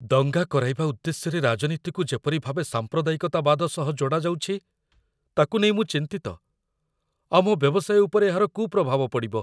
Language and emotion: Odia, fearful